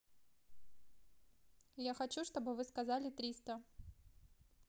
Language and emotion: Russian, neutral